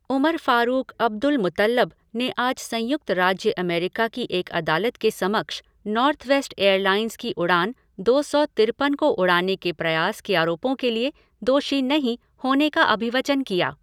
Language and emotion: Hindi, neutral